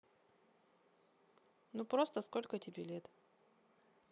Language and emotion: Russian, neutral